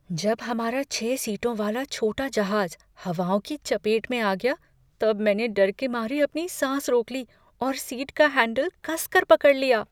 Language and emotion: Hindi, fearful